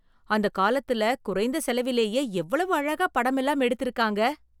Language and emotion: Tamil, surprised